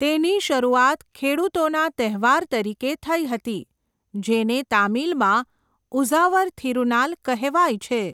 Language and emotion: Gujarati, neutral